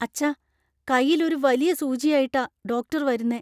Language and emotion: Malayalam, fearful